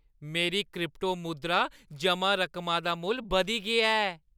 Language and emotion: Dogri, happy